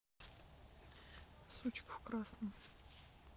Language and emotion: Russian, neutral